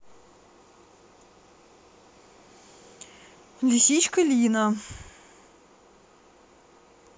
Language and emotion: Russian, neutral